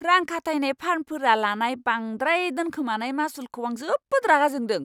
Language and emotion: Bodo, angry